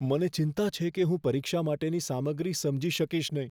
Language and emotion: Gujarati, fearful